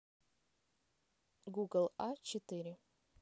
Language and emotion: Russian, neutral